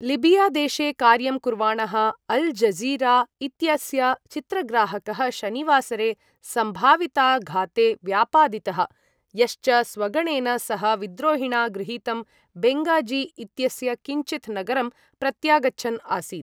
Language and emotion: Sanskrit, neutral